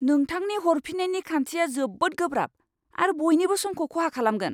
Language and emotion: Bodo, angry